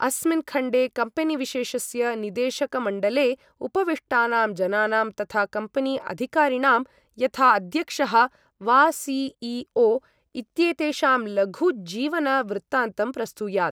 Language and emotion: Sanskrit, neutral